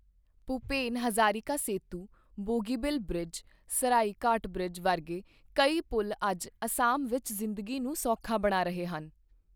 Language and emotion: Punjabi, neutral